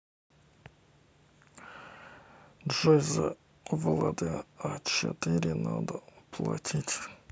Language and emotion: Russian, neutral